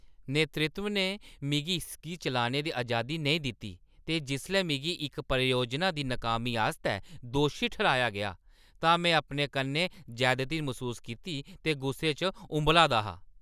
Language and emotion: Dogri, angry